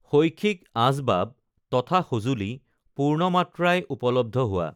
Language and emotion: Assamese, neutral